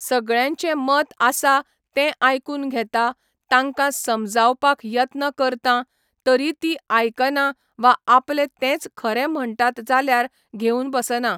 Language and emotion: Goan Konkani, neutral